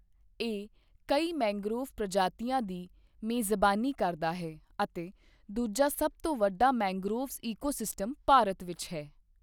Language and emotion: Punjabi, neutral